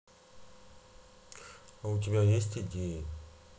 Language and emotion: Russian, sad